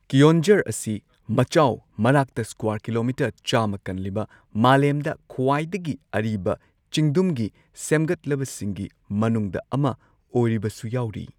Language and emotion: Manipuri, neutral